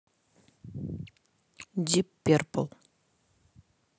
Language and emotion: Russian, neutral